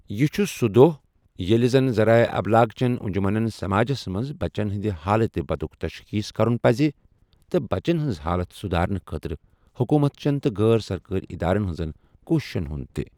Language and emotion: Kashmiri, neutral